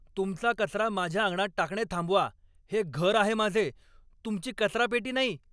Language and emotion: Marathi, angry